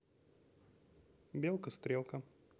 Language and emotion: Russian, neutral